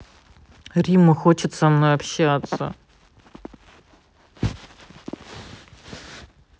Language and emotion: Russian, sad